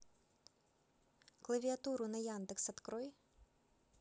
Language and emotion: Russian, neutral